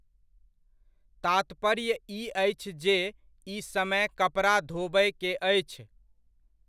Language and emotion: Maithili, neutral